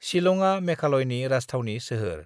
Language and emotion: Bodo, neutral